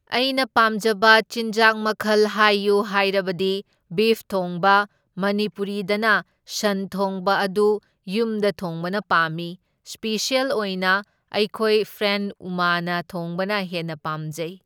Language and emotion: Manipuri, neutral